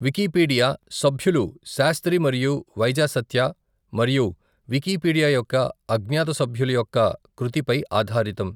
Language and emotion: Telugu, neutral